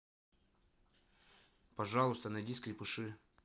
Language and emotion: Russian, neutral